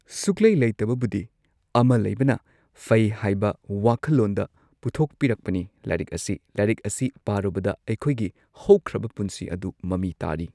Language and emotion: Manipuri, neutral